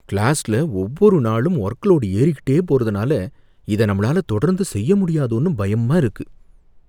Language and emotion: Tamil, fearful